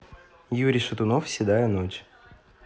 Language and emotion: Russian, neutral